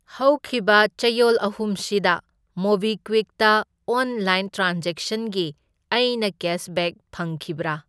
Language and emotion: Manipuri, neutral